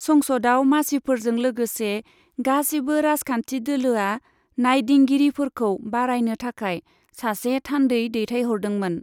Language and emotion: Bodo, neutral